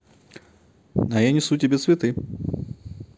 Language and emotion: Russian, positive